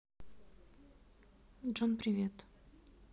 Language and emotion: Russian, sad